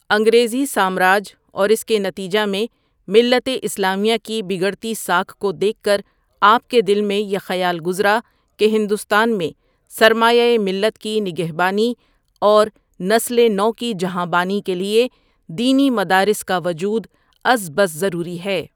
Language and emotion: Urdu, neutral